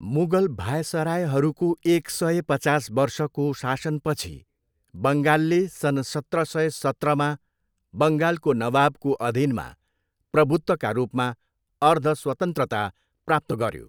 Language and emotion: Nepali, neutral